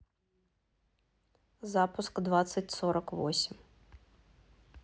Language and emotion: Russian, neutral